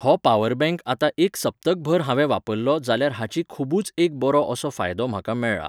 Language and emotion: Goan Konkani, neutral